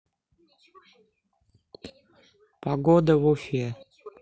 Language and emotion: Russian, neutral